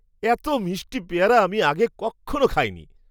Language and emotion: Bengali, surprised